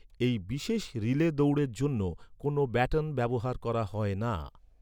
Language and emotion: Bengali, neutral